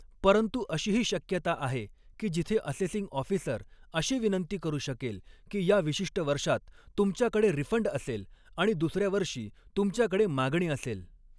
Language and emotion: Marathi, neutral